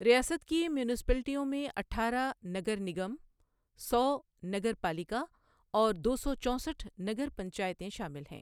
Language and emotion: Urdu, neutral